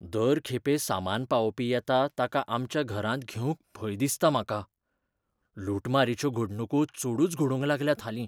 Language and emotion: Goan Konkani, fearful